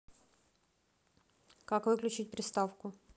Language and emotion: Russian, neutral